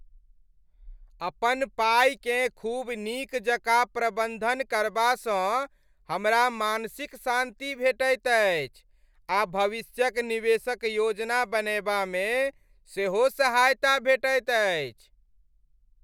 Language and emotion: Maithili, happy